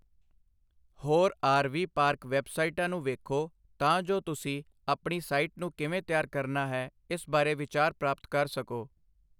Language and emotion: Punjabi, neutral